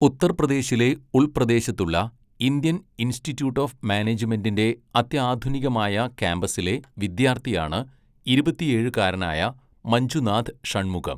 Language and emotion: Malayalam, neutral